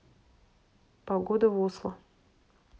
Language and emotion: Russian, neutral